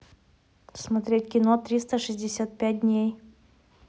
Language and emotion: Russian, neutral